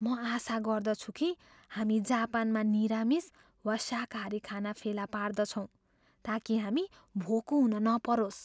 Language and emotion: Nepali, fearful